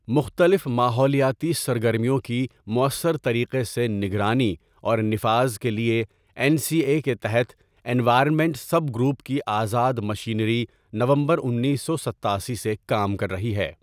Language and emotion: Urdu, neutral